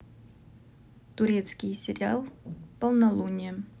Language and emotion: Russian, neutral